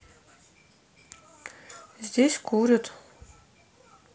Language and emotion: Russian, neutral